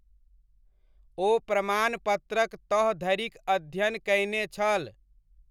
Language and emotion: Maithili, neutral